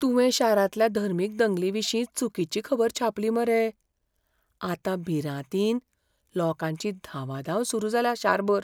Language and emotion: Goan Konkani, fearful